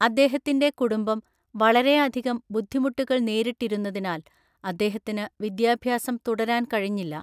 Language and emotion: Malayalam, neutral